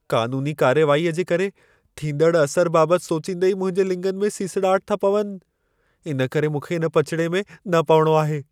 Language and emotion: Sindhi, fearful